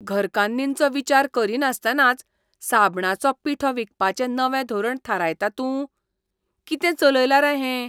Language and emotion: Goan Konkani, disgusted